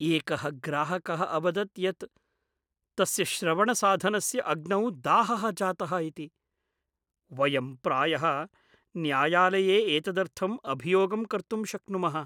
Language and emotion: Sanskrit, fearful